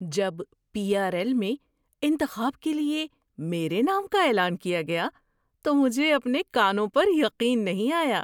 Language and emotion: Urdu, surprised